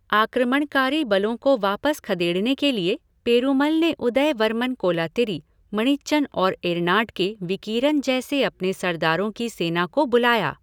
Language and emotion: Hindi, neutral